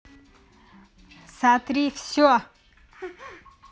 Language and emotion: Russian, angry